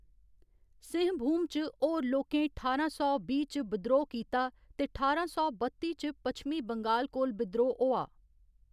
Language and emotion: Dogri, neutral